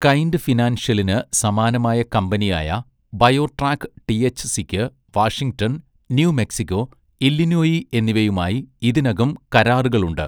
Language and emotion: Malayalam, neutral